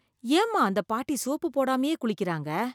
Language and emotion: Tamil, disgusted